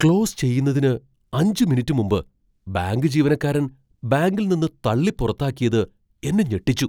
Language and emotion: Malayalam, surprised